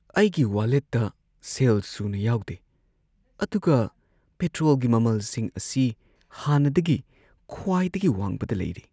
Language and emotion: Manipuri, sad